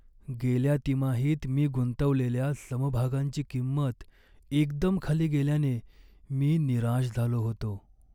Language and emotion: Marathi, sad